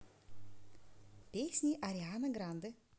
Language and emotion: Russian, positive